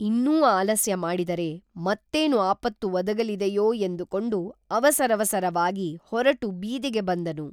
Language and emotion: Kannada, neutral